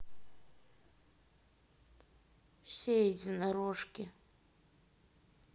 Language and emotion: Russian, sad